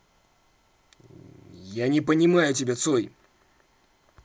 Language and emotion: Russian, angry